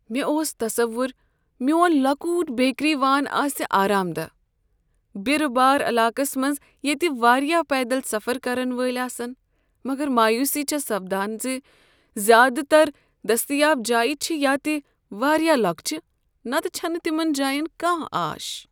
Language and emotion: Kashmiri, sad